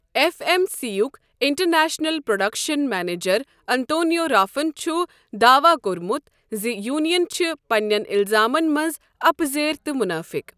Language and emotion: Kashmiri, neutral